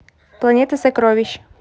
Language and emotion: Russian, neutral